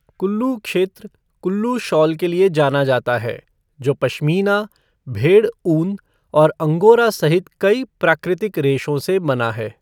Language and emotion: Hindi, neutral